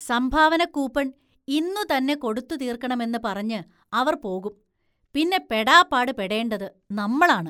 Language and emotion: Malayalam, disgusted